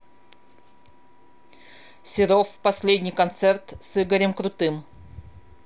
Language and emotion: Russian, neutral